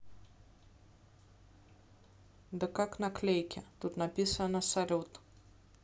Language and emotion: Russian, neutral